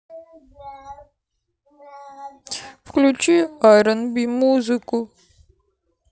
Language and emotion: Russian, sad